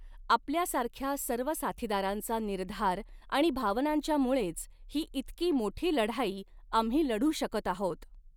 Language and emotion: Marathi, neutral